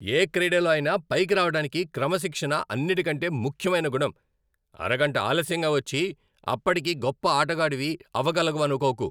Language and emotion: Telugu, angry